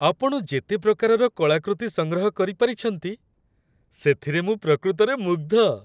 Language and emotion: Odia, happy